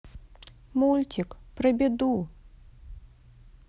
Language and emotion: Russian, sad